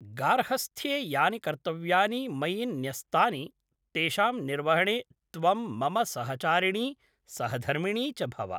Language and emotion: Sanskrit, neutral